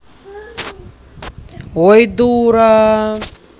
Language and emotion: Russian, angry